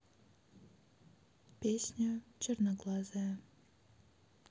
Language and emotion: Russian, neutral